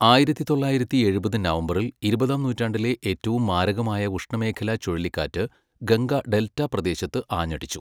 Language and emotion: Malayalam, neutral